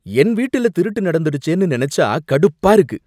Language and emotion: Tamil, angry